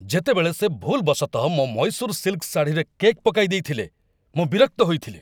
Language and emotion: Odia, angry